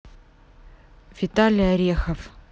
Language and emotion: Russian, neutral